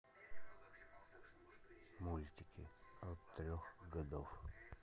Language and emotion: Russian, neutral